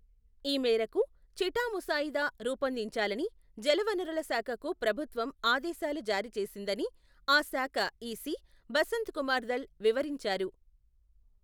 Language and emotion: Telugu, neutral